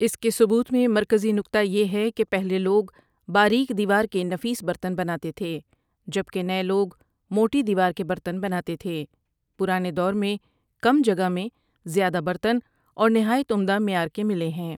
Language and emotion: Urdu, neutral